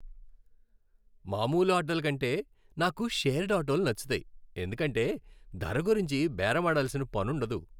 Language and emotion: Telugu, happy